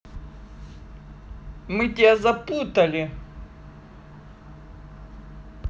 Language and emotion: Russian, neutral